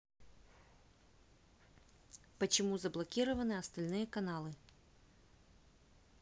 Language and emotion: Russian, neutral